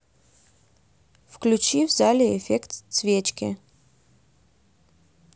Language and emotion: Russian, neutral